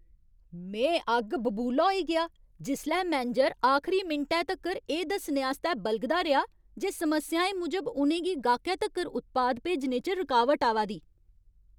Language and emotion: Dogri, angry